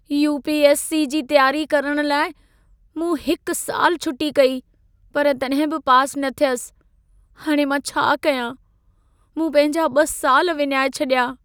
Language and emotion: Sindhi, sad